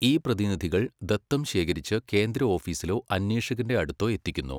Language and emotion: Malayalam, neutral